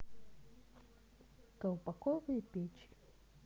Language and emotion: Russian, neutral